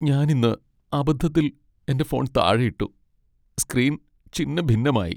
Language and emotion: Malayalam, sad